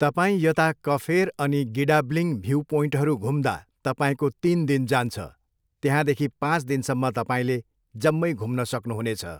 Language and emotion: Nepali, neutral